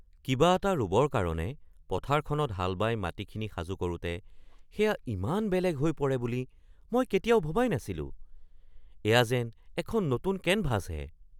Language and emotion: Assamese, surprised